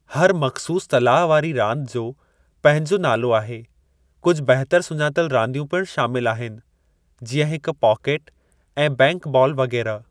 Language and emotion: Sindhi, neutral